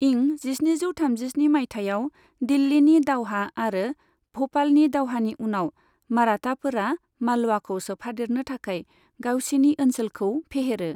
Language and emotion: Bodo, neutral